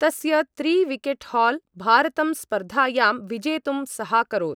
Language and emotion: Sanskrit, neutral